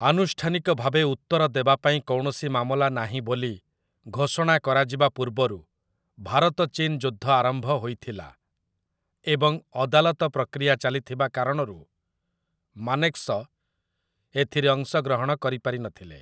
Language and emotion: Odia, neutral